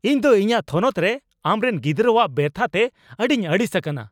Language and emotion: Santali, angry